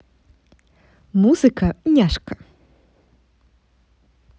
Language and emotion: Russian, positive